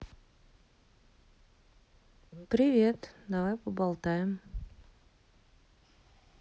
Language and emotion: Russian, neutral